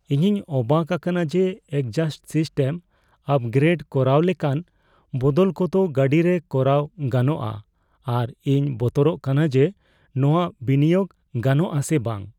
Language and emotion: Santali, fearful